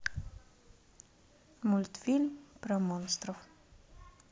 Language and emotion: Russian, neutral